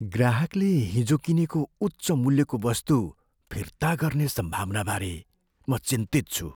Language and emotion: Nepali, fearful